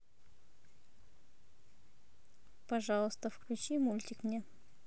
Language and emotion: Russian, neutral